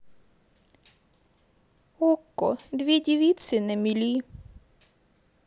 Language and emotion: Russian, sad